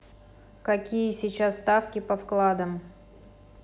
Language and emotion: Russian, neutral